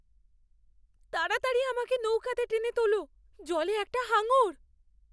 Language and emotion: Bengali, fearful